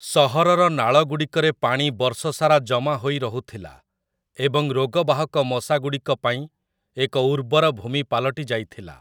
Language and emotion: Odia, neutral